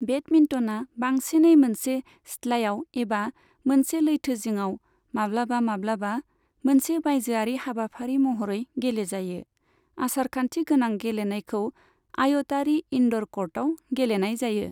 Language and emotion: Bodo, neutral